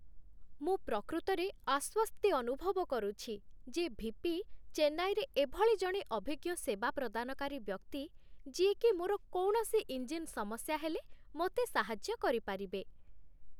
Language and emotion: Odia, happy